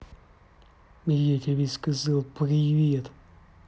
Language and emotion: Russian, angry